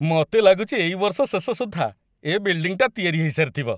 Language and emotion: Odia, happy